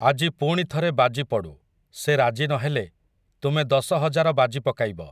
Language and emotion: Odia, neutral